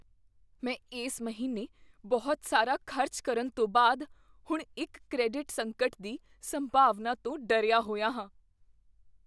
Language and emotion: Punjabi, fearful